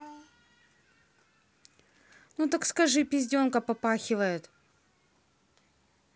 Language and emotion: Russian, neutral